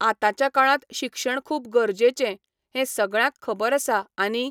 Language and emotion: Goan Konkani, neutral